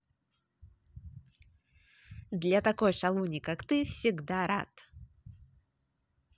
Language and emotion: Russian, positive